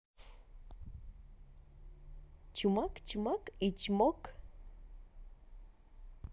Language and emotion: Russian, positive